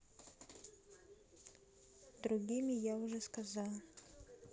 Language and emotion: Russian, neutral